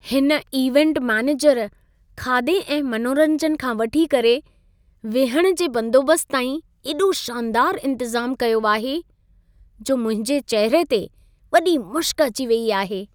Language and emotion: Sindhi, happy